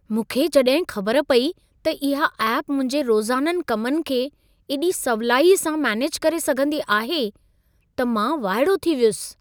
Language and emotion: Sindhi, surprised